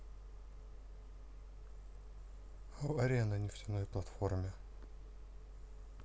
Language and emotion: Russian, neutral